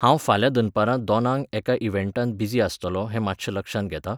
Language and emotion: Goan Konkani, neutral